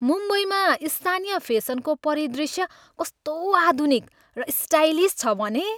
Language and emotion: Nepali, happy